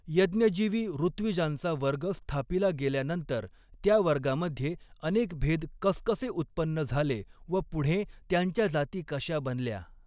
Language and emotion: Marathi, neutral